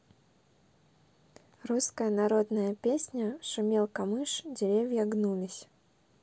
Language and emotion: Russian, neutral